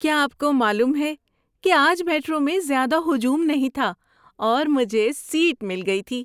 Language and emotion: Urdu, happy